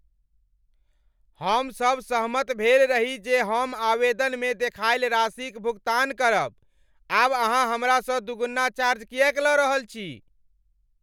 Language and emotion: Maithili, angry